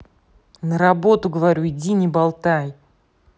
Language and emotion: Russian, angry